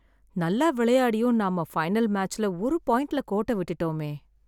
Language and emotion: Tamil, sad